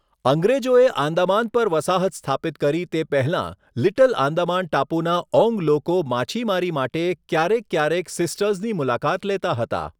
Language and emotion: Gujarati, neutral